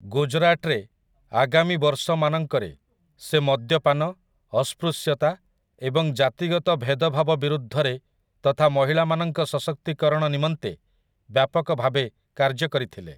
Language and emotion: Odia, neutral